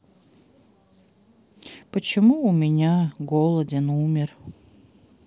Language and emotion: Russian, sad